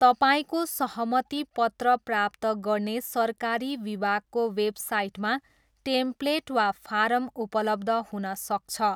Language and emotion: Nepali, neutral